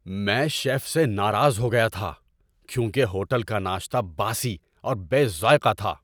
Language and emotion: Urdu, angry